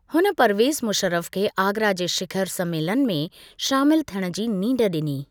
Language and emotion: Sindhi, neutral